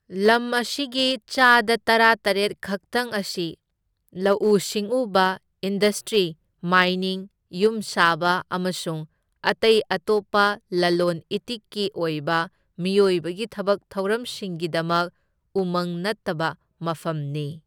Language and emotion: Manipuri, neutral